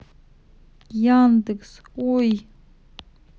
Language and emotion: Russian, sad